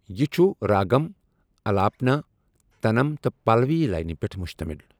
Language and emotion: Kashmiri, neutral